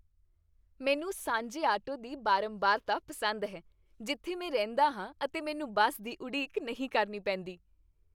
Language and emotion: Punjabi, happy